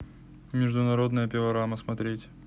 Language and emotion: Russian, neutral